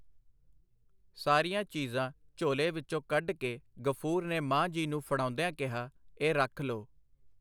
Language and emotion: Punjabi, neutral